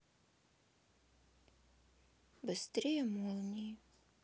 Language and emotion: Russian, sad